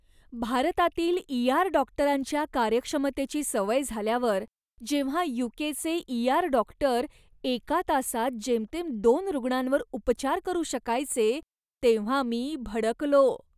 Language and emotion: Marathi, disgusted